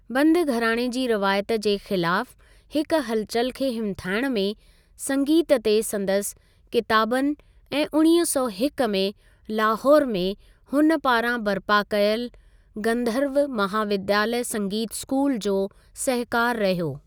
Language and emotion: Sindhi, neutral